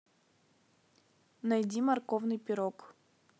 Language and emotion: Russian, neutral